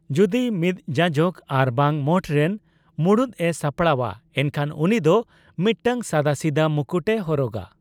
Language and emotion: Santali, neutral